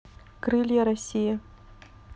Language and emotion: Russian, neutral